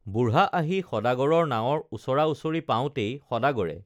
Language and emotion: Assamese, neutral